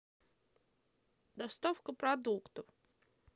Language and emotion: Russian, neutral